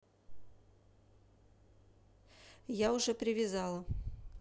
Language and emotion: Russian, neutral